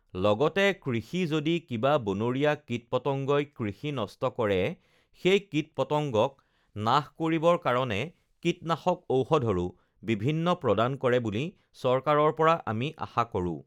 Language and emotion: Assamese, neutral